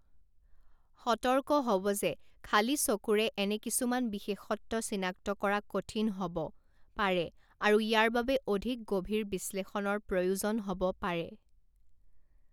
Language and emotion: Assamese, neutral